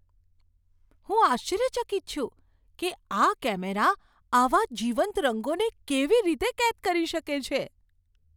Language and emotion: Gujarati, surprised